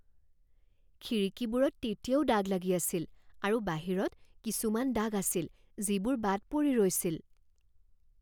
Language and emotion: Assamese, fearful